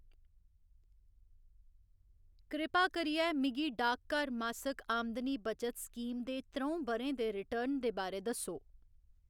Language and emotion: Dogri, neutral